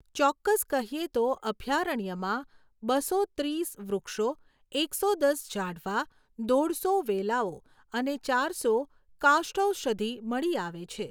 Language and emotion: Gujarati, neutral